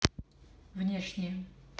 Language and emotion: Russian, neutral